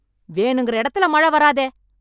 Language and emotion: Tamil, angry